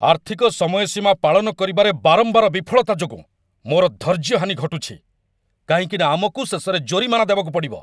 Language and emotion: Odia, angry